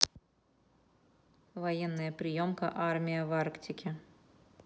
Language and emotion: Russian, neutral